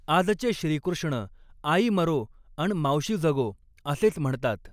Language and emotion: Marathi, neutral